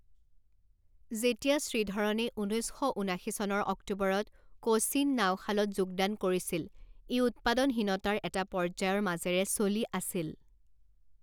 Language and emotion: Assamese, neutral